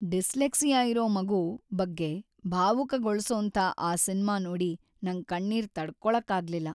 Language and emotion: Kannada, sad